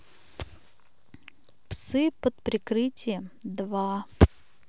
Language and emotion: Russian, neutral